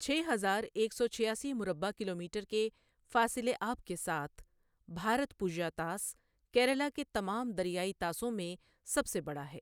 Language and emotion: Urdu, neutral